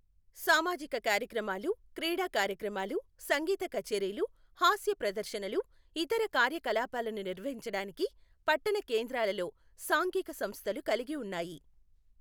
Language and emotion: Telugu, neutral